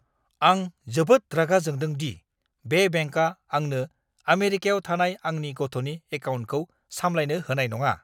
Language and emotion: Bodo, angry